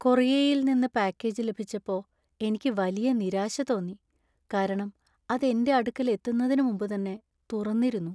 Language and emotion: Malayalam, sad